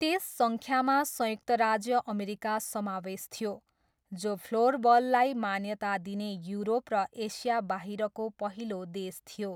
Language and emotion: Nepali, neutral